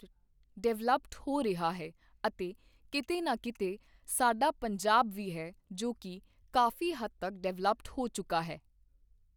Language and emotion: Punjabi, neutral